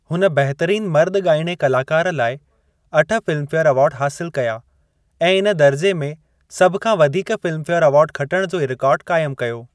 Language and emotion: Sindhi, neutral